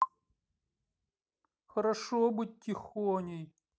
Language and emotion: Russian, sad